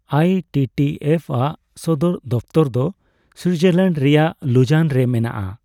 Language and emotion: Santali, neutral